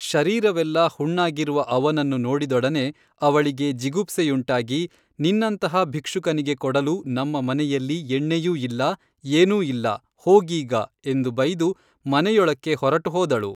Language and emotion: Kannada, neutral